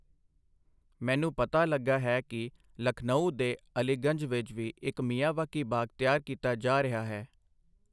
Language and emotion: Punjabi, neutral